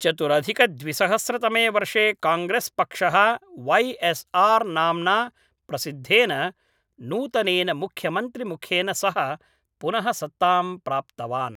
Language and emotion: Sanskrit, neutral